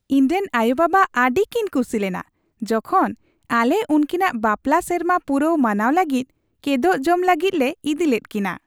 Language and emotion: Santali, happy